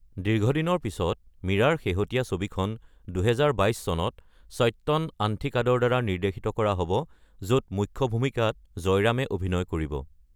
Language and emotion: Assamese, neutral